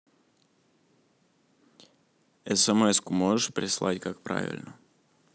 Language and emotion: Russian, neutral